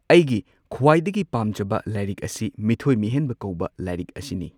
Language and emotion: Manipuri, neutral